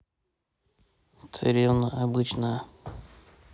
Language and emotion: Russian, neutral